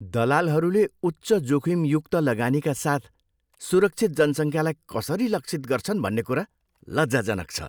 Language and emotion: Nepali, disgusted